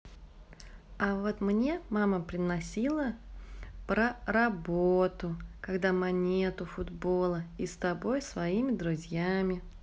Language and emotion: Russian, positive